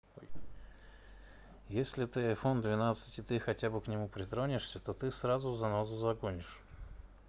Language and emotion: Russian, neutral